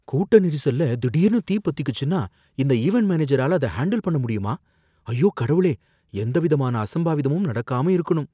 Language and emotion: Tamil, fearful